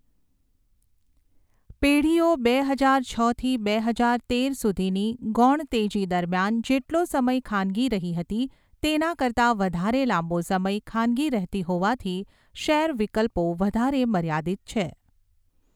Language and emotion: Gujarati, neutral